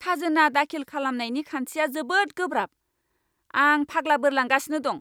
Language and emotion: Bodo, angry